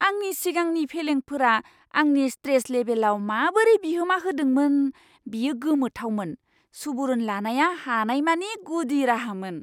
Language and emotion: Bodo, surprised